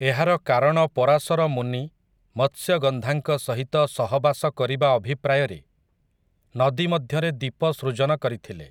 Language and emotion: Odia, neutral